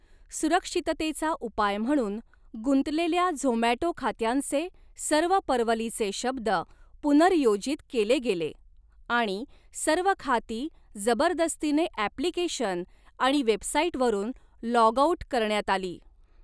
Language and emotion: Marathi, neutral